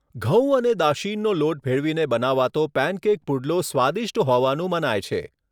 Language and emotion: Gujarati, neutral